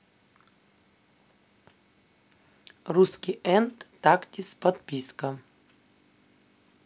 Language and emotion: Russian, neutral